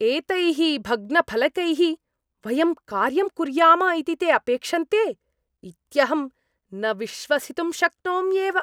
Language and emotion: Sanskrit, disgusted